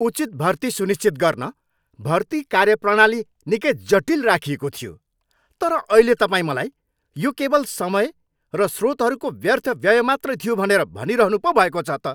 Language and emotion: Nepali, angry